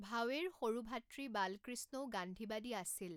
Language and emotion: Assamese, neutral